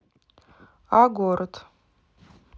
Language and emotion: Russian, neutral